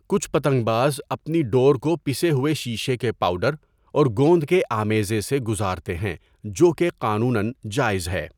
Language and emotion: Urdu, neutral